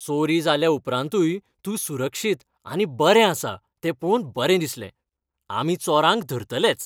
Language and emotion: Goan Konkani, happy